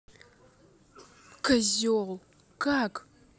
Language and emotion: Russian, angry